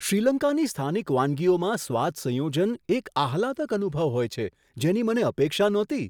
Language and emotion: Gujarati, surprised